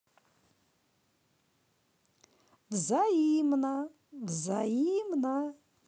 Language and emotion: Russian, positive